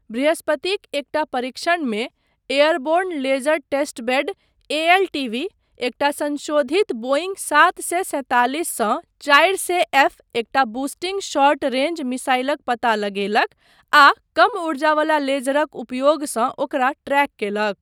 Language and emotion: Maithili, neutral